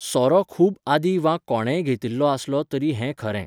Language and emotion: Goan Konkani, neutral